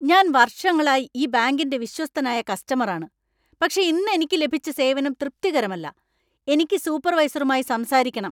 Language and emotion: Malayalam, angry